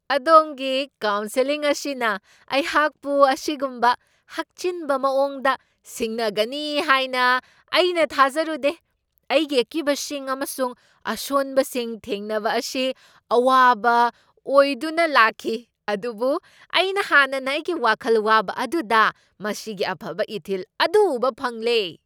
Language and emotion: Manipuri, surprised